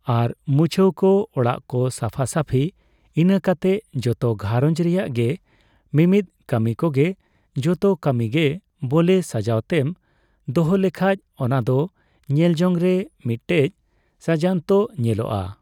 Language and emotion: Santali, neutral